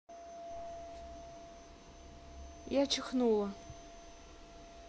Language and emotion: Russian, neutral